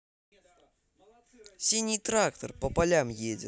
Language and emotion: Russian, positive